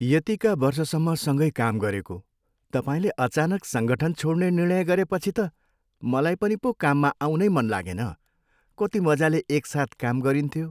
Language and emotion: Nepali, sad